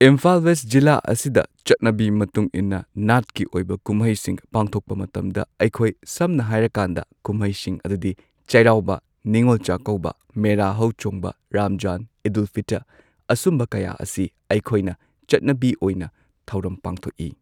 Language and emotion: Manipuri, neutral